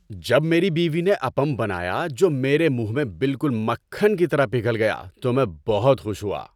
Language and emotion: Urdu, happy